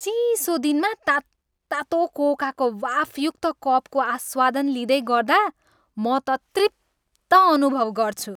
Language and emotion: Nepali, happy